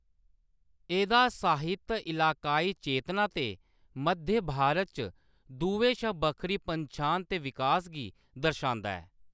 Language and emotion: Dogri, neutral